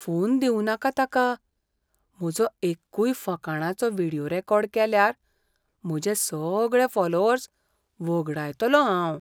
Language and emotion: Goan Konkani, fearful